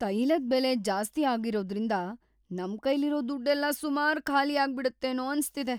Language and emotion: Kannada, fearful